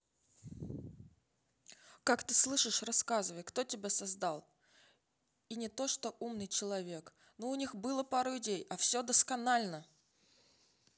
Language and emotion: Russian, neutral